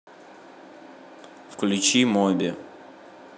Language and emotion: Russian, neutral